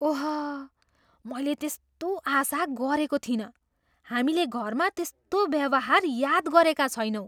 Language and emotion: Nepali, surprised